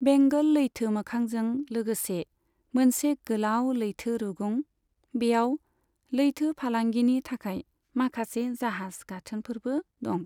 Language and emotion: Bodo, neutral